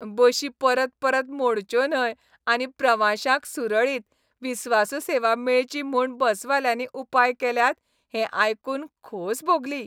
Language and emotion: Goan Konkani, happy